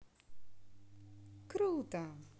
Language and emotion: Russian, positive